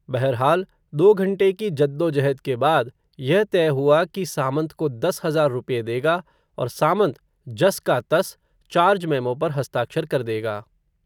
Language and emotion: Hindi, neutral